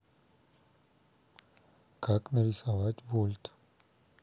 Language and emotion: Russian, neutral